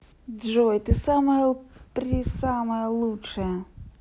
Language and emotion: Russian, positive